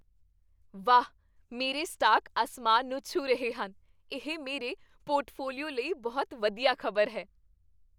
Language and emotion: Punjabi, happy